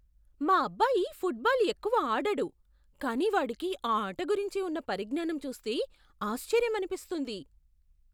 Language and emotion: Telugu, surprised